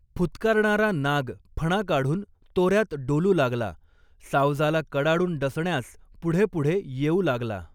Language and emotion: Marathi, neutral